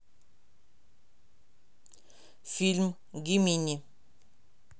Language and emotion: Russian, neutral